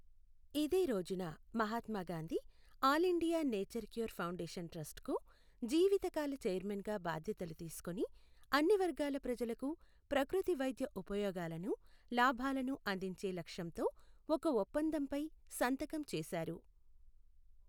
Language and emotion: Telugu, neutral